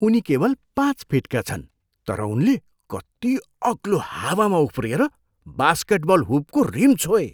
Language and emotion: Nepali, surprised